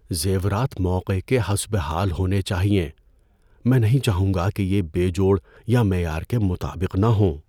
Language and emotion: Urdu, fearful